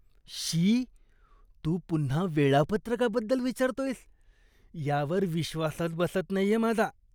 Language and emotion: Marathi, disgusted